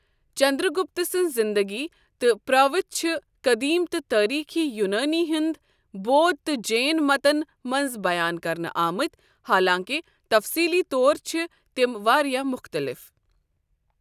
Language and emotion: Kashmiri, neutral